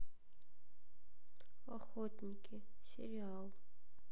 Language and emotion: Russian, sad